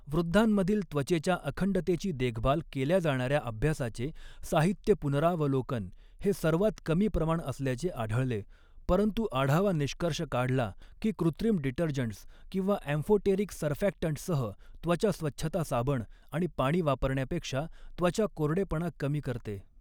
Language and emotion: Marathi, neutral